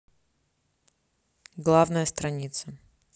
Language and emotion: Russian, neutral